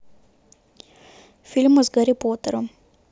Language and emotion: Russian, neutral